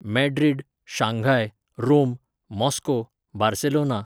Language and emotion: Goan Konkani, neutral